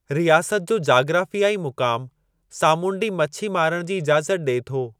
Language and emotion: Sindhi, neutral